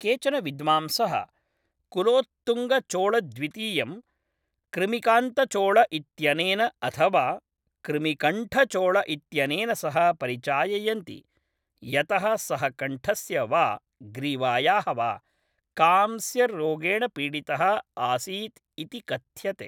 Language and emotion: Sanskrit, neutral